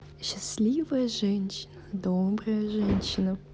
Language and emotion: Russian, positive